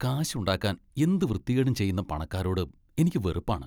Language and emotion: Malayalam, disgusted